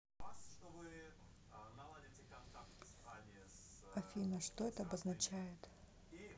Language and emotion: Russian, neutral